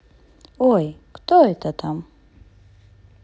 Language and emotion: Russian, positive